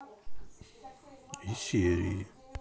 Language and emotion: Russian, sad